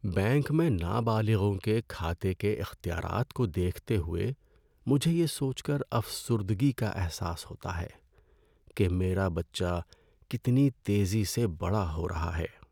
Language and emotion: Urdu, sad